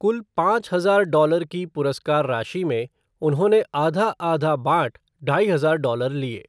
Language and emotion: Hindi, neutral